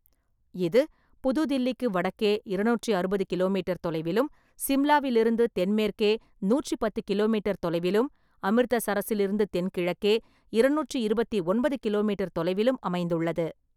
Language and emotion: Tamil, neutral